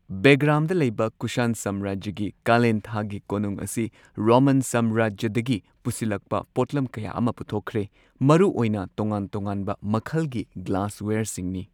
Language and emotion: Manipuri, neutral